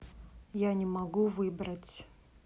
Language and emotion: Russian, neutral